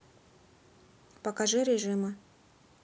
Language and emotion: Russian, neutral